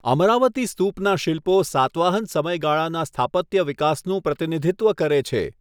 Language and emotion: Gujarati, neutral